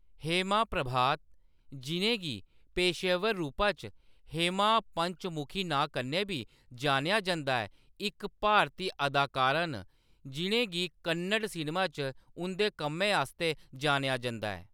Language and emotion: Dogri, neutral